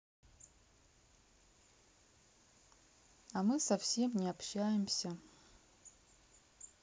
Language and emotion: Russian, sad